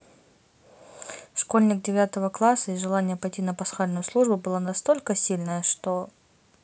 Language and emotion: Russian, neutral